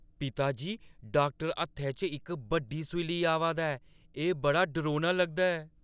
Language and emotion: Dogri, fearful